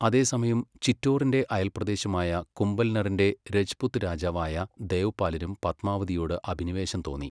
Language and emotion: Malayalam, neutral